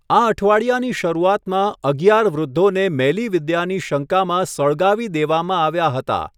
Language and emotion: Gujarati, neutral